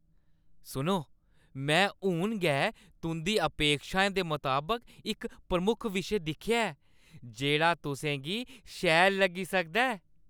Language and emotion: Dogri, happy